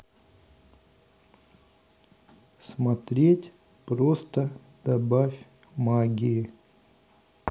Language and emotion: Russian, neutral